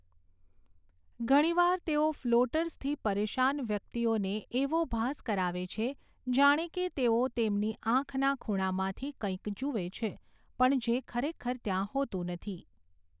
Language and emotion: Gujarati, neutral